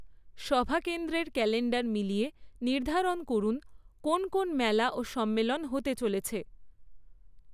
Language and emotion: Bengali, neutral